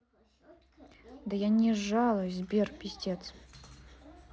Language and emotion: Russian, angry